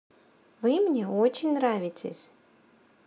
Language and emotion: Russian, positive